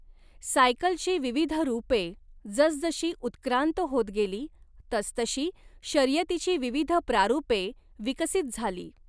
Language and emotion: Marathi, neutral